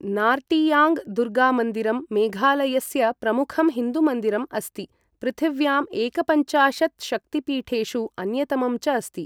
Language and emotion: Sanskrit, neutral